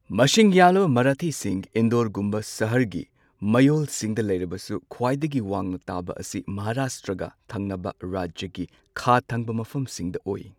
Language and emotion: Manipuri, neutral